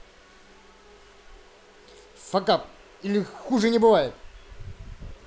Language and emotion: Russian, angry